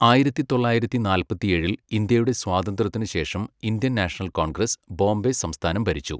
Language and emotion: Malayalam, neutral